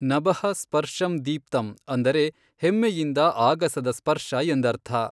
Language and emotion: Kannada, neutral